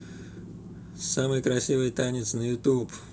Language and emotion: Russian, positive